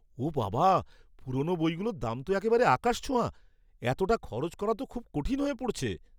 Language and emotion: Bengali, surprised